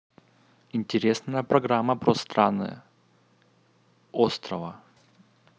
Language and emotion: Russian, neutral